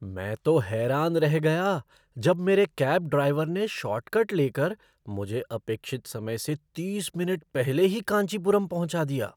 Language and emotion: Hindi, surprised